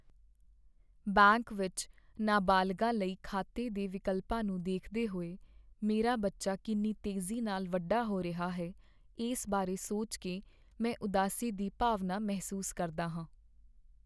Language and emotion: Punjabi, sad